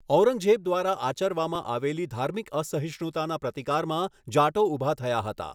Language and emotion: Gujarati, neutral